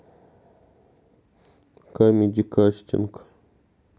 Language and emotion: Russian, neutral